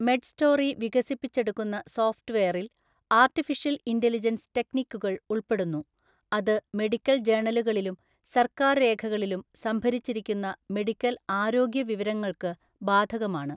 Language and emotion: Malayalam, neutral